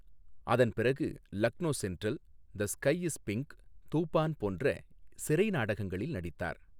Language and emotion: Tamil, neutral